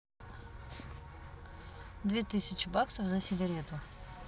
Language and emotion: Russian, neutral